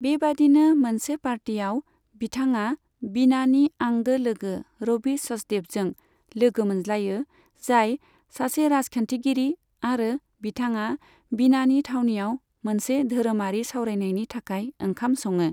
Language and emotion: Bodo, neutral